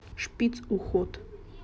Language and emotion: Russian, neutral